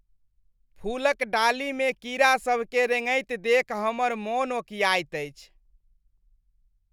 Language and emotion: Maithili, disgusted